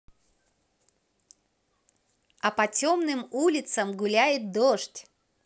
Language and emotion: Russian, positive